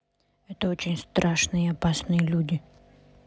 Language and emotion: Russian, neutral